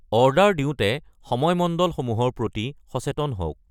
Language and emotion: Assamese, neutral